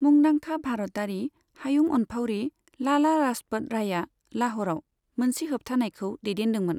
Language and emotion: Bodo, neutral